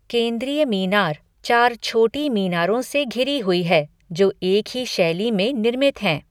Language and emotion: Hindi, neutral